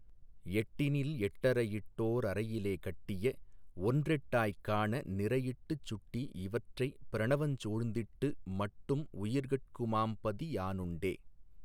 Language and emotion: Tamil, neutral